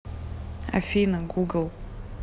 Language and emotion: Russian, neutral